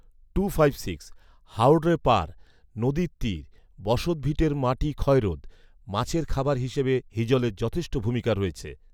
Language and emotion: Bengali, neutral